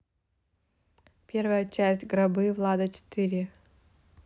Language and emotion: Russian, neutral